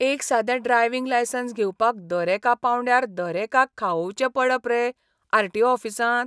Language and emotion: Goan Konkani, disgusted